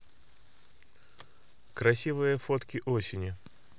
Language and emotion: Russian, neutral